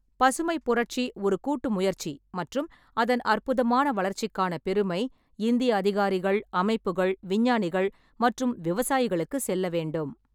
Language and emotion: Tamil, neutral